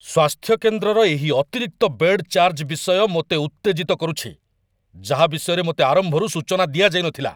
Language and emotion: Odia, angry